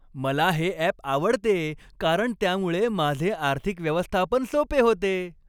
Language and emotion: Marathi, happy